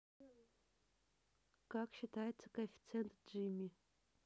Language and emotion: Russian, neutral